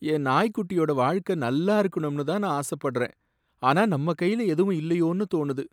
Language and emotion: Tamil, sad